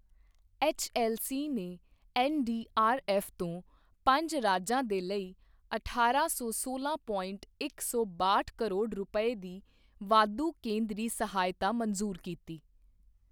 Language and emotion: Punjabi, neutral